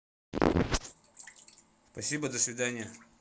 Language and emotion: Russian, neutral